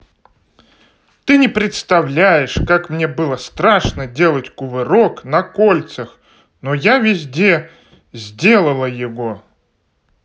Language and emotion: Russian, positive